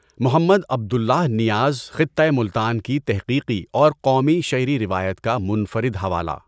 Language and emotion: Urdu, neutral